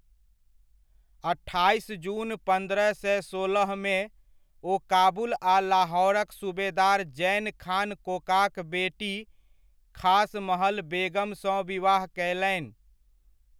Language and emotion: Maithili, neutral